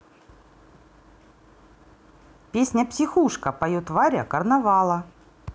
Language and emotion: Russian, neutral